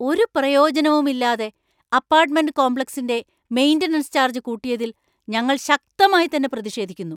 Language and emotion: Malayalam, angry